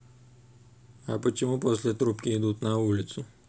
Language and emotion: Russian, neutral